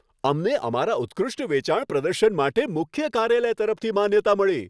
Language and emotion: Gujarati, happy